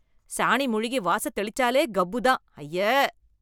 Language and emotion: Tamil, disgusted